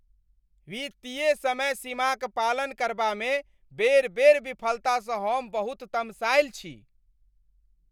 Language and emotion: Maithili, angry